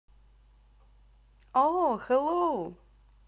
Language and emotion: Russian, positive